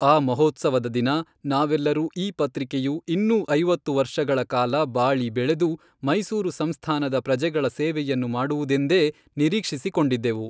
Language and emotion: Kannada, neutral